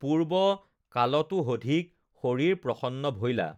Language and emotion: Assamese, neutral